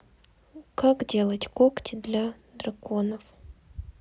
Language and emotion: Russian, sad